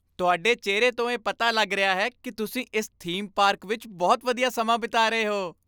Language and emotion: Punjabi, happy